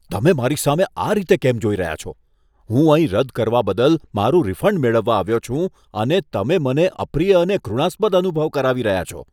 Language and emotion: Gujarati, disgusted